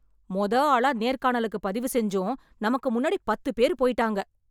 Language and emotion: Tamil, angry